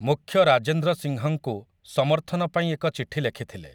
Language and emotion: Odia, neutral